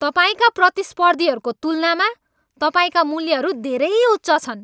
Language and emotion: Nepali, angry